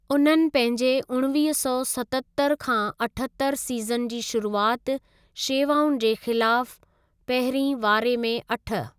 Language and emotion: Sindhi, neutral